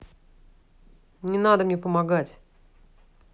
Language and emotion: Russian, angry